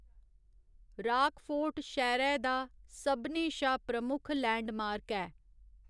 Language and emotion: Dogri, neutral